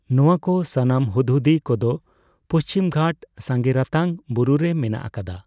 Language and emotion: Santali, neutral